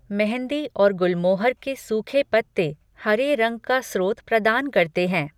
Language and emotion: Hindi, neutral